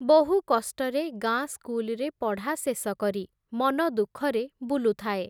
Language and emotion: Odia, neutral